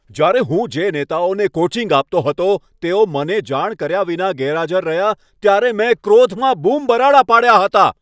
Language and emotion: Gujarati, angry